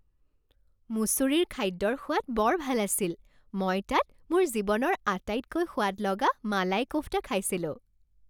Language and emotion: Assamese, happy